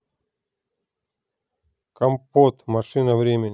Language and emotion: Russian, neutral